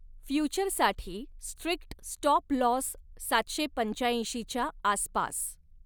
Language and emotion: Marathi, neutral